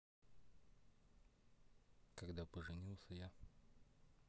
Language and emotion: Russian, neutral